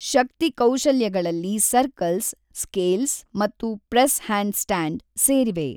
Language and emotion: Kannada, neutral